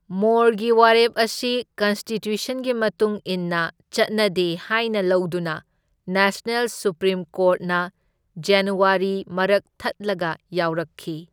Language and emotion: Manipuri, neutral